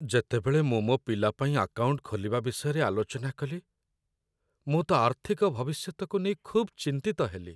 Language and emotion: Odia, sad